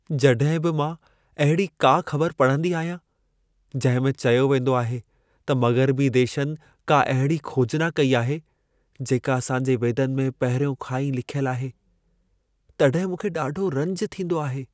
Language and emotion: Sindhi, sad